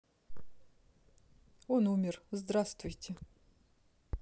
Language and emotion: Russian, neutral